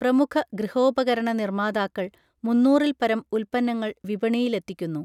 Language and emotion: Malayalam, neutral